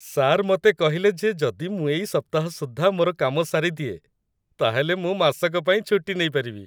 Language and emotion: Odia, happy